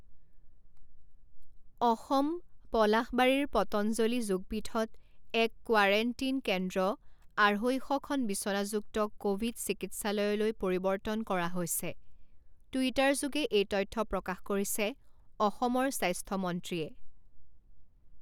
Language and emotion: Assamese, neutral